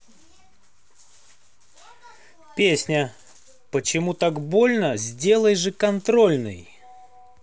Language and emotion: Russian, positive